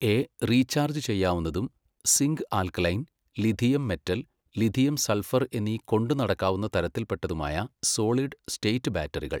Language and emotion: Malayalam, neutral